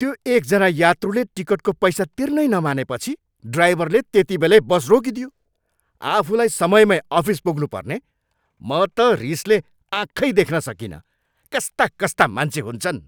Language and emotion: Nepali, angry